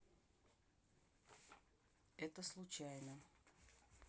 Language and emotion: Russian, neutral